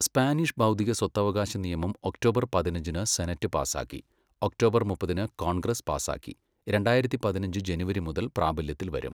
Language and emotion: Malayalam, neutral